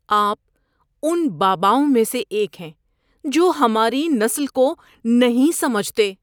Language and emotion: Urdu, disgusted